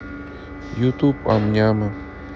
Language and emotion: Russian, neutral